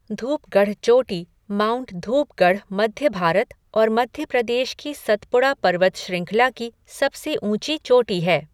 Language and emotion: Hindi, neutral